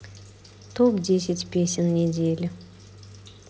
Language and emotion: Russian, neutral